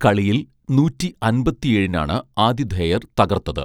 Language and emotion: Malayalam, neutral